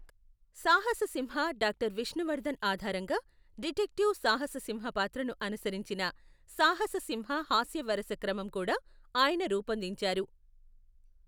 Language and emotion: Telugu, neutral